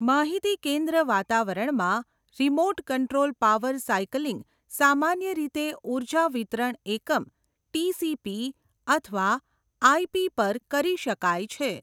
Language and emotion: Gujarati, neutral